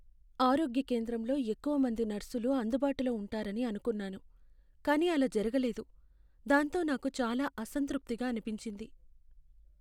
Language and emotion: Telugu, sad